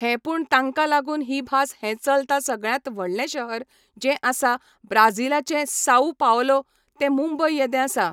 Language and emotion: Goan Konkani, neutral